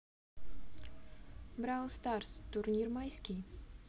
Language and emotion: Russian, neutral